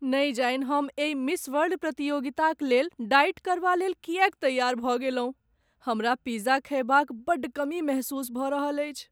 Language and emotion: Maithili, sad